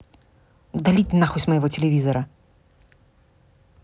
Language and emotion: Russian, angry